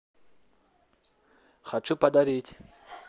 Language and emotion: Russian, neutral